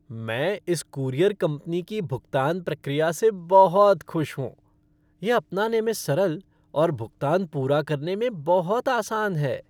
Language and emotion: Hindi, happy